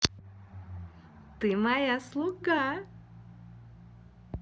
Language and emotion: Russian, positive